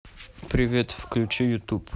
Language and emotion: Russian, neutral